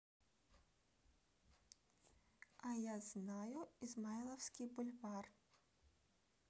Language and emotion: Russian, neutral